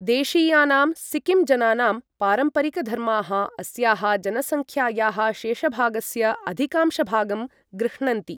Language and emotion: Sanskrit, neutral